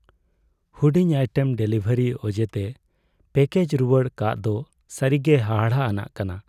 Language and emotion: Santali, sad